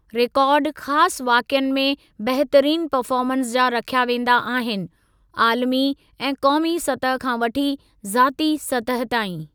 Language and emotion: Sindhi, neutral